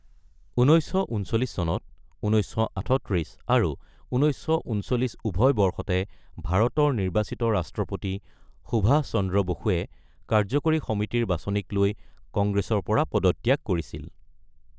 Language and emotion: Assamese, neutral